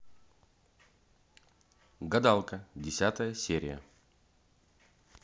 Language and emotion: Russian, neutral